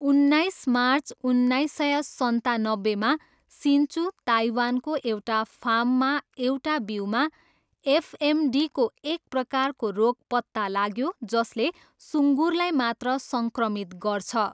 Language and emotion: Nepali, neutral